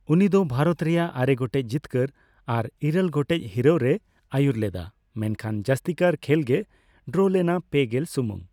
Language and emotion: Santali, neutral